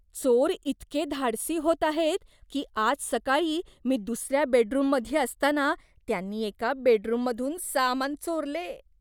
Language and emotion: Marathi, disgusted